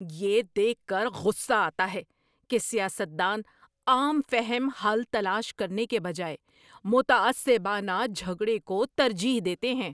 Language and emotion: Urdu, angry